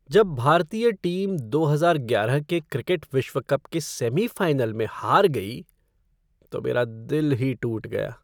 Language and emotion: Hindi, sad